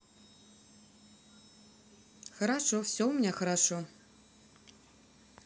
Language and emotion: Russian, positive